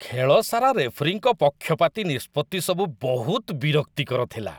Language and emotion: Odia, disgusted